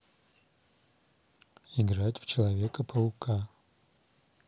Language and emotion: Russian, neutral